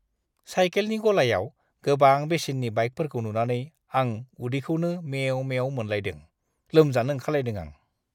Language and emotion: Bodo, disgusted